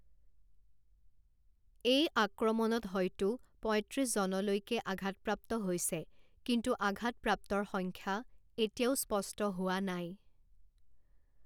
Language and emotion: Assamese, neutral